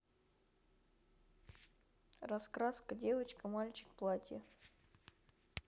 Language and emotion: Russian, neutral